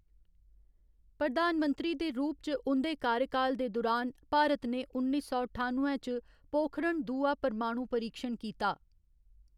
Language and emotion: Dogri, neutral